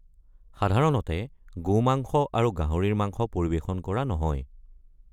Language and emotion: Assamese, neutral